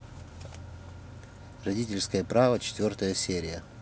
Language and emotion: Russian, neutral